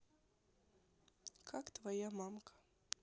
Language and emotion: Russian, sad